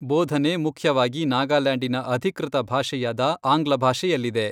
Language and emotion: Kannada, neutral